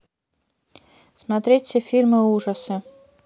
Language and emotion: Russian, neutral